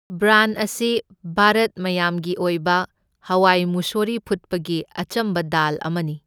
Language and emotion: Manipuri, neutral